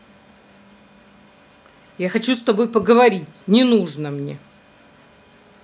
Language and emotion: Russian, angry